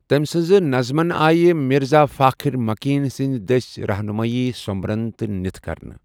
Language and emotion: Kashmiri, neutral